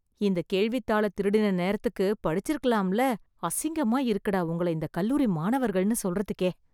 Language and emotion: Tamil, disgusted